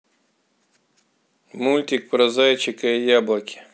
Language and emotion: Russian, neutral